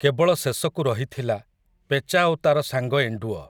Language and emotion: Odia, neutral